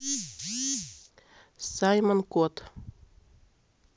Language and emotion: Russian, neutral